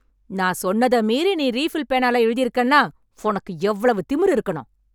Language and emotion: Tamil, angry